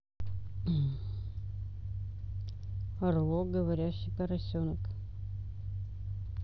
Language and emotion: Russian, neutral